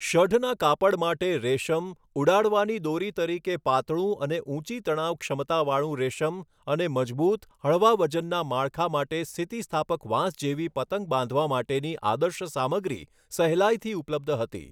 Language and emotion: Gujarati, neutral